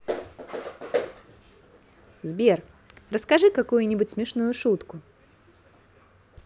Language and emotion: Russian, positive